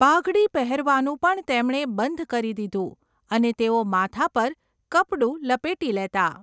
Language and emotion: Gujarati, neutral